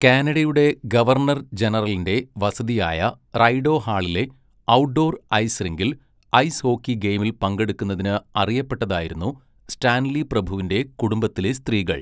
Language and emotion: Malayalam, neutral